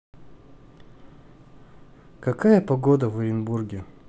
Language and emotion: Russian, neutral